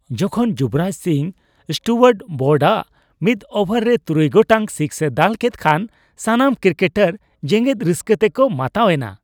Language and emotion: Santali, happy